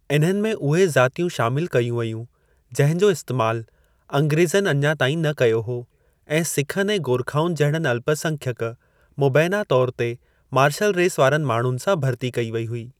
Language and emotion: Sindhi, neutral